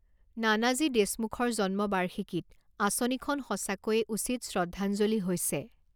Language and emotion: Assamese, neutral